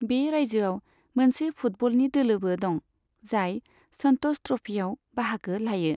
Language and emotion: Bodo, neutral